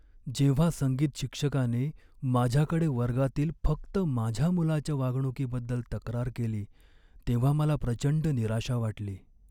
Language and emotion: Marathi, sad